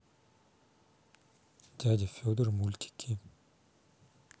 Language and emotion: Russian, neutral